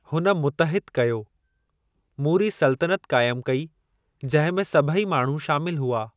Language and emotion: Sindhi, neutral